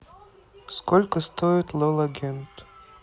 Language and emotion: Russian, neutral